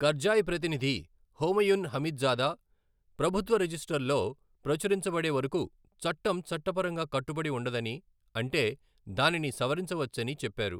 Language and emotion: Telugu, neutral